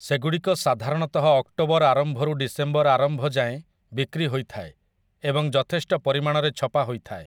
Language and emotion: Odia, neutral